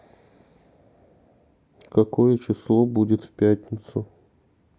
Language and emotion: Russian, neutral